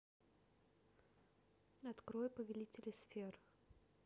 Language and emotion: Russian, neutral